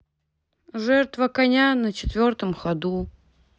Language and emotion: Russian, sad